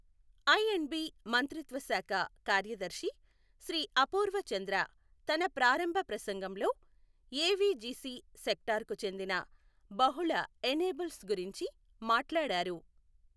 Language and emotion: Telugu, neutral